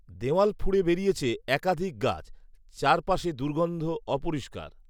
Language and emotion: Bengali, neutral